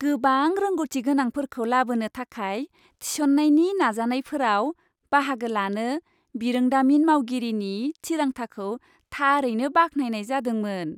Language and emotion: Bodo, happy